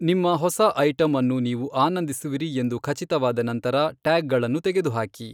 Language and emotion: Kannada, neutral